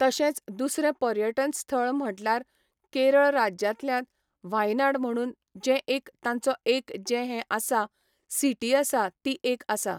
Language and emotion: Goan Konkani, neutral